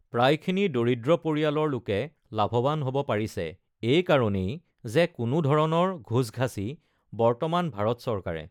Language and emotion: Assamese, neutral